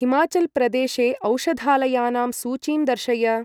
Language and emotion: Sanskrit, neutral